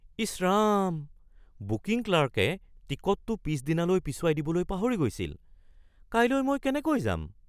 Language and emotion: Assamese, surprised